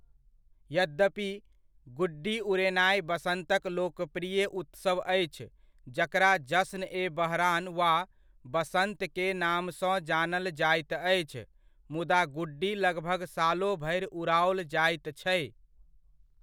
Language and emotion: Maithili, neutral